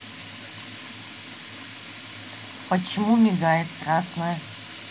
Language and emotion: Russian, neutral